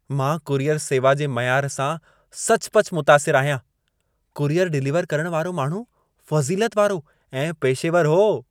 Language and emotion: Sindhi, happy